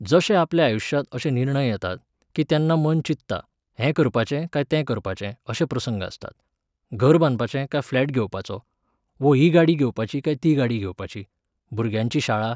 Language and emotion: Goan Konkani, neutral